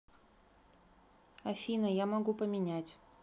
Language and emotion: Russian, neutral